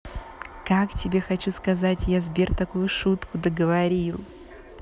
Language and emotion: Russian, positive